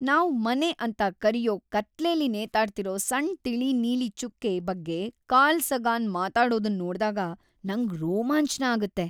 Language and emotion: Kannada, happy